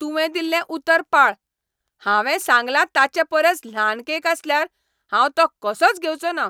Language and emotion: Goan Konkani, angry